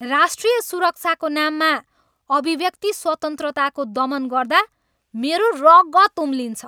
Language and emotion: Nepali, angry